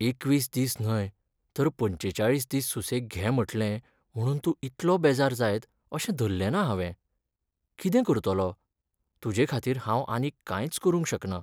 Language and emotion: Goan Konkani, sad